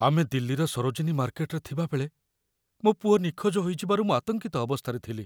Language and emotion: Odia, fearful